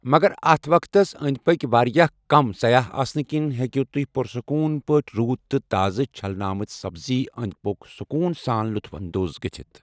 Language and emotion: Kashmiri, neutral